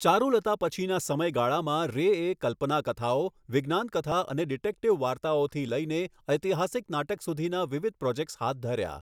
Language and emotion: Gujarati, neutral